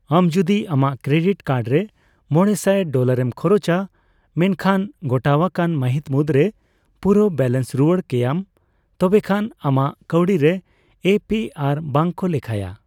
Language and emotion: Santali, neutral